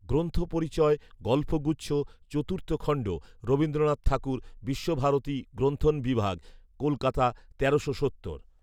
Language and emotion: Bengali, neutral